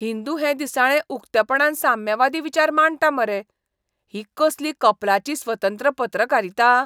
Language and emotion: Goan Konkani, disgusted